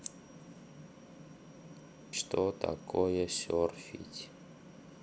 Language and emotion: Russian, neutral